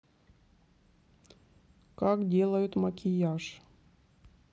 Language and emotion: Russian, neutral